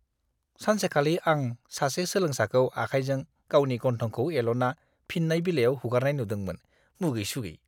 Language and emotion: Bodo, disgusted